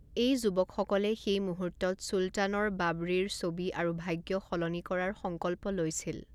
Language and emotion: Assamese, neutral